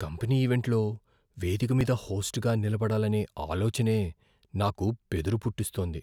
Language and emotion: Telugu, fearful